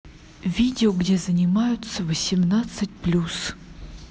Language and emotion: Russian, neutral